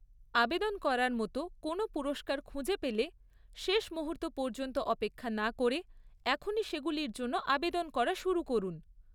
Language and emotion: Bengali, neutral